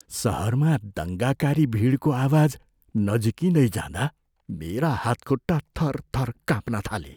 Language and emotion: Nepali, fearful